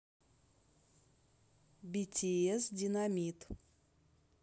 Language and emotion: Russian, neutral